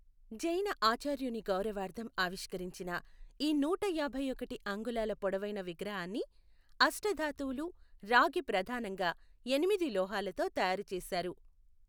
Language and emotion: Telugu, neutral